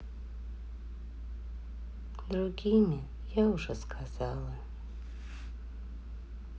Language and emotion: Russian, sad